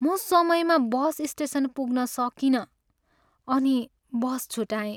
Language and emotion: Nepali, sad